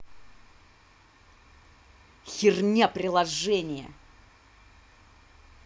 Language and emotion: Russian, angry